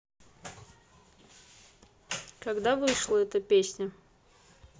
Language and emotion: Russian, neutral